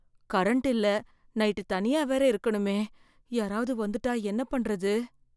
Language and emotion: Tamil, fearful